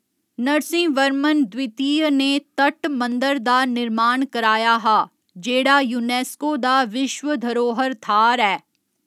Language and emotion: Dogri, neutral